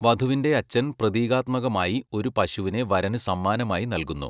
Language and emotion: Malayalam, neutral